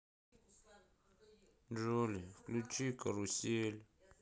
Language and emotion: Russian, sad